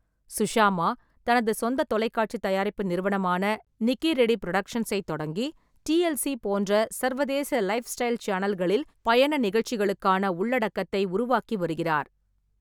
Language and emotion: Tamil, neutral